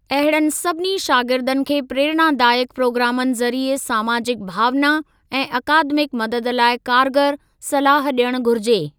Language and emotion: Sindhi, neutral